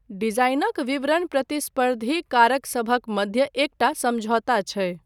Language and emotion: Maithili, neutral